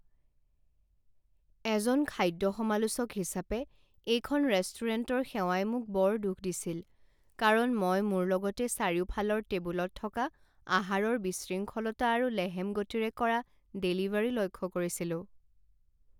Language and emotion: Assamese, sad